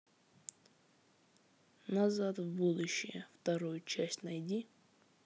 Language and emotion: Russian, neutral